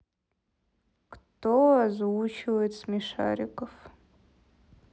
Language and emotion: Russian, sad